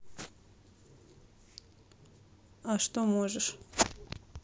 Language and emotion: Russian, neutral